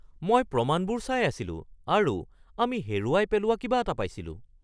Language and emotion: Assamese, surprised